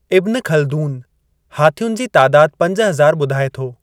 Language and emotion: Sindhi, neutral